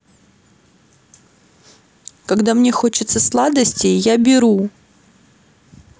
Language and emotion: Russian, sad